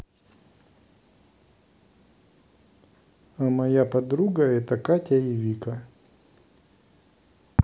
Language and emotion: Russian, neutral